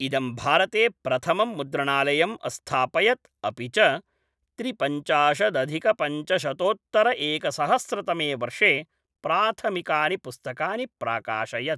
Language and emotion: Sanskrit, neutral